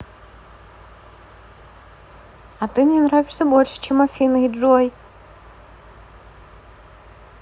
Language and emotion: Russian, positive